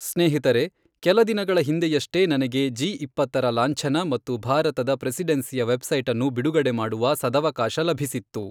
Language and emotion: Kannada, neutral